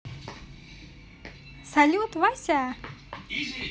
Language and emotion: Russian, positive